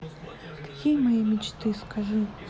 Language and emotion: Russian, sad